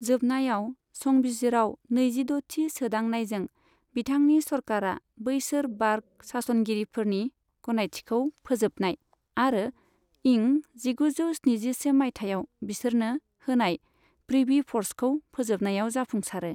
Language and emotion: Bodo, neutral